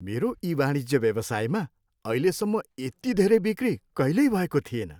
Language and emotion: Nepali, happy